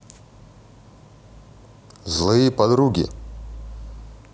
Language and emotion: Russian, neutral